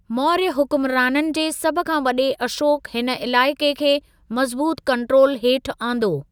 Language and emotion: Sindhi, neutral